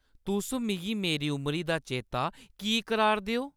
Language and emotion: Dogri, angry